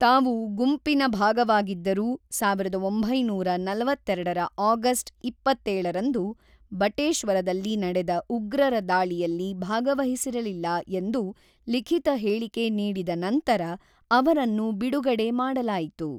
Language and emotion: Kannada, neutral